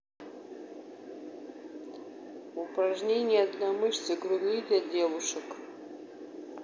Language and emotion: Russian, neutral